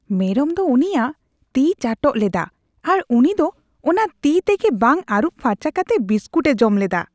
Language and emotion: Santali, disgusted